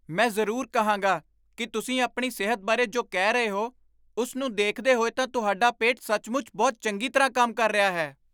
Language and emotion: Punjabi, surprised